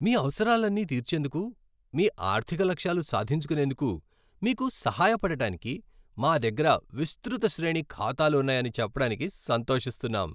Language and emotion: Telugu, happy